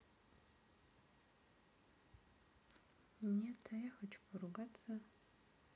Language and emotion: Russian, neutral